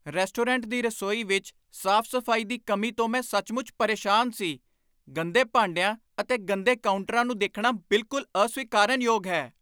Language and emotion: Punjabi, angry